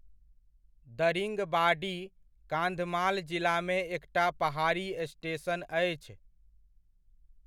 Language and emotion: Maithili, neutral